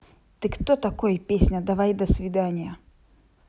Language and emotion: Russian, angry